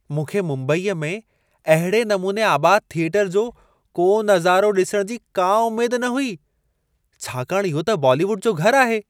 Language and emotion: Sindhi, surprised